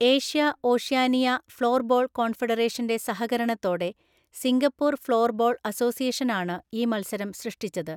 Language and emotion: Malayalam, neutral